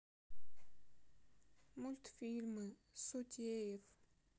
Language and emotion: Russian, sad